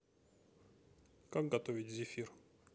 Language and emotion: Russian, neutral